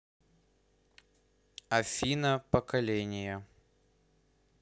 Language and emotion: Russian, neutral